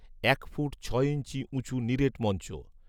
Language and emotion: Bengali, neutral